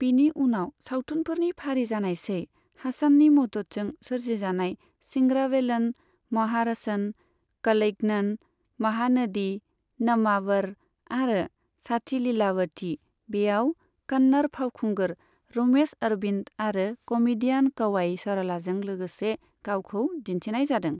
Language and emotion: Bodo, neutral